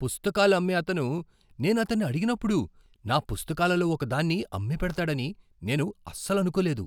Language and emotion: Telugu, surprised